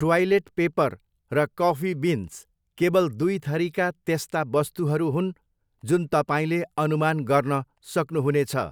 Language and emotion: Nepali, neutral